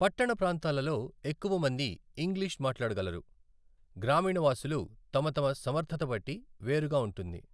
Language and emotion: Telugu, neutral